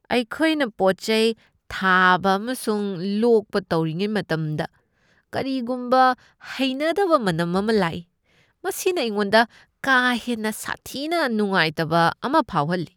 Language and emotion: Manipuri, disgusted